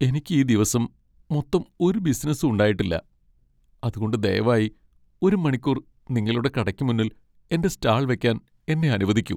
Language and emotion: Malayalam, sad